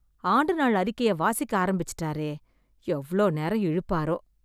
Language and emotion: Tamil, disgusted